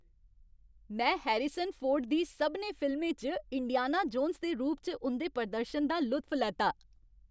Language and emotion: Dogri, happy